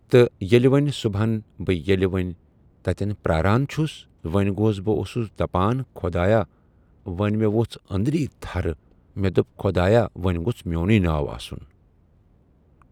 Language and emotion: Kashmiri, neutral